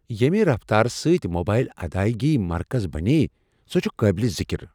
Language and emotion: Kashmiri, surprised